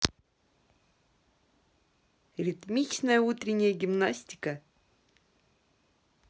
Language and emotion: Russian, positive